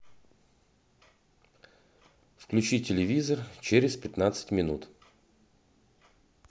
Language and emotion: Russian, neutral